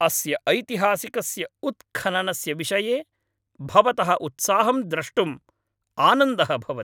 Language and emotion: Sanskrit, happy